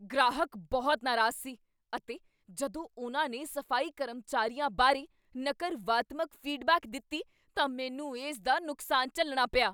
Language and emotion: Punjabi, angry